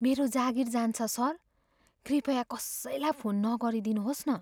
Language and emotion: Nepali, fearful